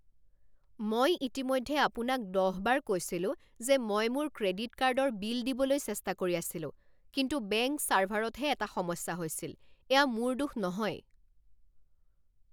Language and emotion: Assamese, angry